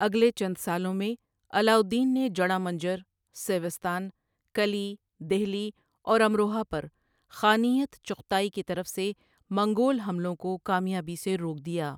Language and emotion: Urdu, neutral